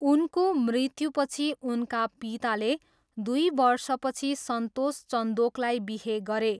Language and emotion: Nepali, neutral